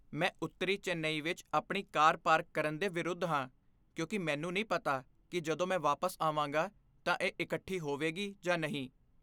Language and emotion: Punjabi, fearful